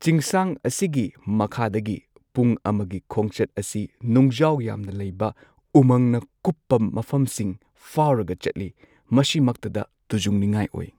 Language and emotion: Manipuri, neutral